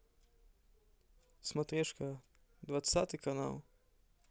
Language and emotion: Russian, neutral